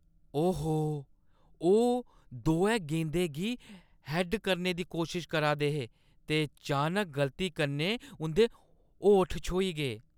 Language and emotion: Dogri, disgusted